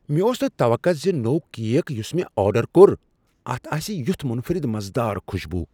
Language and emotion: Kashmiri, surprised